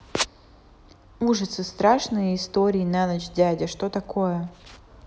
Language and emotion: Russian, neutral